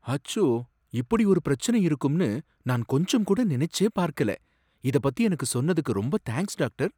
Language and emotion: Tamil, surprised